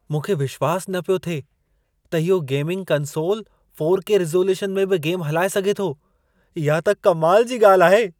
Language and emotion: Sindhi, surprised